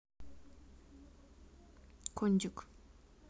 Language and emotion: Russian, neutral